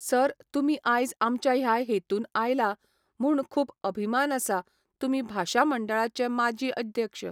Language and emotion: Goan Konkani, neutral